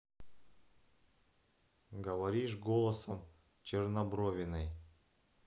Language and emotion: Russian, neutral